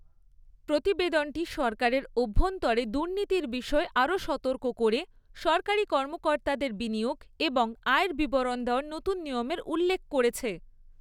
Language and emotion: Bengali, neutral